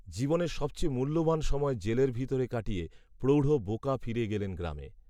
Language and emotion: Bengali, neutral